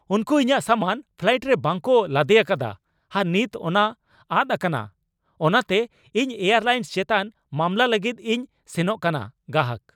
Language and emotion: Santali, angry